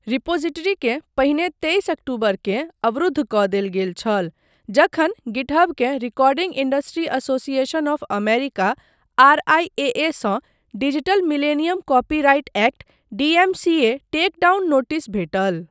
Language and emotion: Maithili, neutral